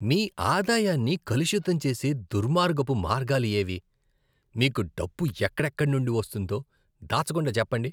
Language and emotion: Telugu, disgusted